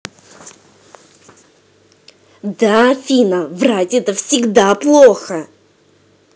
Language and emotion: Russian, angry